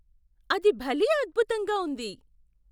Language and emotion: Telugu, surprised